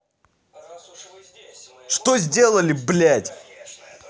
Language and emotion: Russian, angry